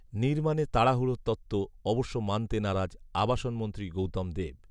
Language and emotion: Bengali, neutral